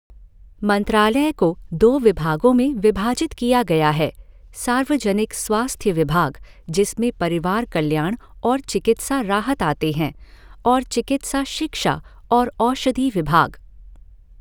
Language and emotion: Hindi, neutral